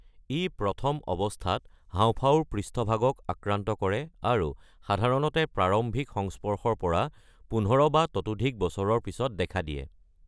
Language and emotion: Assamese, neutral